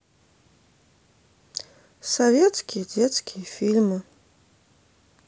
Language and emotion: Russian, sad